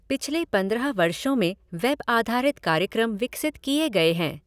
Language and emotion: Hindi, neutral